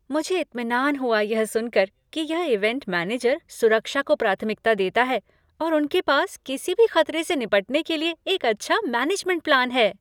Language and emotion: Hindi, happy